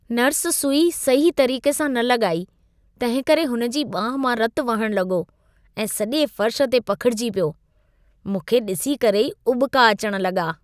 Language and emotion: Sindhi, disgusted